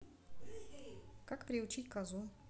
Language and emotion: Russian, neutral